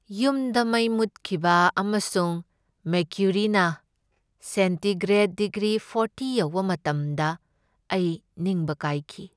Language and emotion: Manipuri, sad